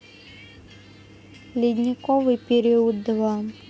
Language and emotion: Russian, neutral